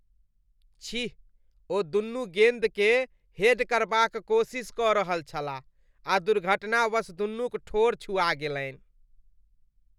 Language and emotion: Maithili, disgusted